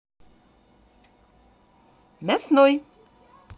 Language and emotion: Russian, positive